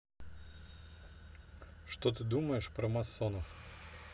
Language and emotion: Russian, neutral